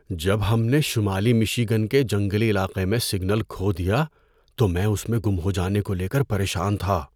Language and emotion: Urdu, fearful